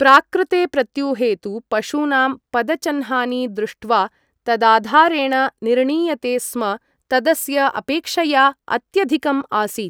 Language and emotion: Sanskrit, neutral